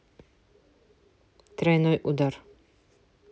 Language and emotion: Russian, neutral